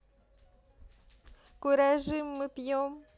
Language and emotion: Russian, positive